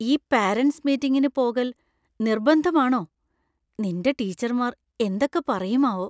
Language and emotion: Malayalam, fearful